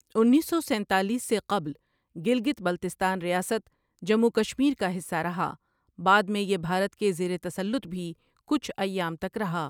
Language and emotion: Urdu, neutral